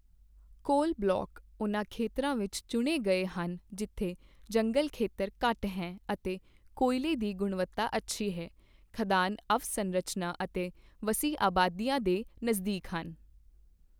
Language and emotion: Punjabi, neutral